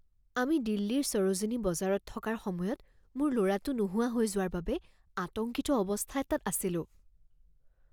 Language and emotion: Assamese, fearful